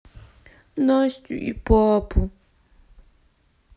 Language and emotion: Russian, sad